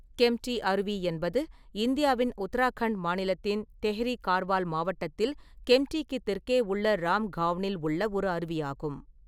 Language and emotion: Tamil, neutral